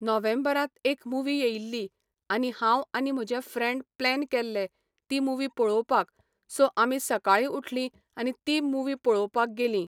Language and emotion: Goan Konkani, neutral